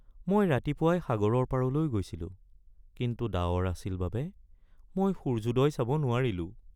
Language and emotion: Assamese, sad